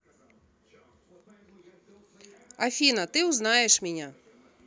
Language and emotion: Russian, neutral